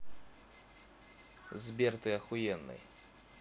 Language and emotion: Russian, positive